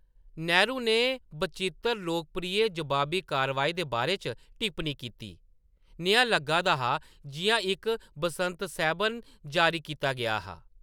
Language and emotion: Dogri, neutral